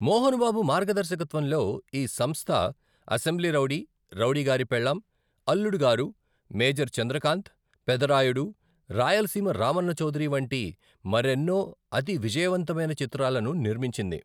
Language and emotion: Telugu, neutral